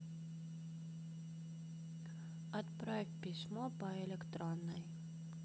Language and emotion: Russian, neutral